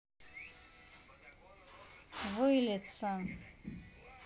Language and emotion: Russian, neutral